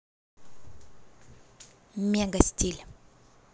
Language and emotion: Russian, positive